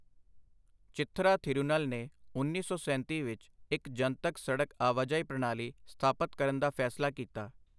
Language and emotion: Punjabi, neutral